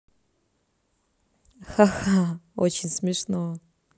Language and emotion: Russian, positive